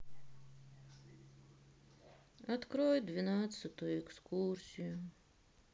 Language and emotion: Russian, sad